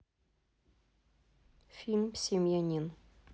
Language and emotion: Russian, neutral